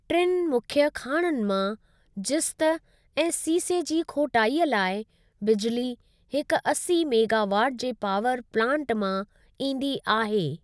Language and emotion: Sindhi, neutral